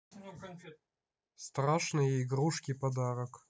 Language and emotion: Russian, neutral